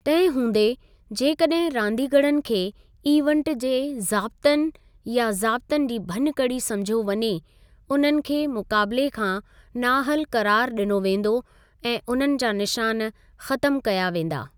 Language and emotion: Sindhi, neutral